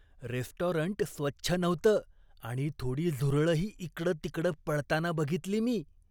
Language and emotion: Marathi, disgusted